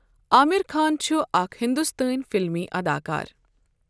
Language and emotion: Kashmiri, neutral